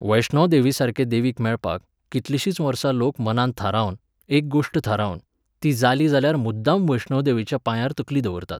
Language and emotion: Goan Konkani, neutral